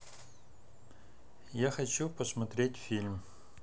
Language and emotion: Russian, neutral